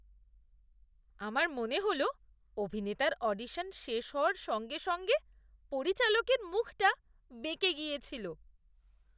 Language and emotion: Bengali, disgusted